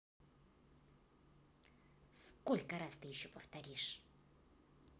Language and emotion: Russian, angry